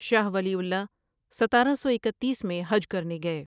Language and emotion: Urdu, neutral